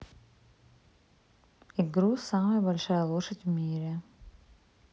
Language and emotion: Russian, neutral